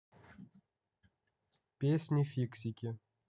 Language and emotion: Russian, neutral